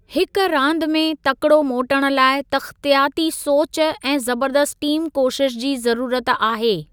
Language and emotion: Sindhi, neutral